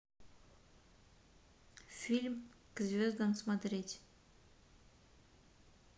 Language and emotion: Russian, neutral